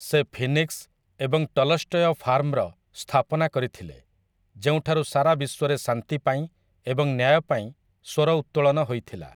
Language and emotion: Odia, neutral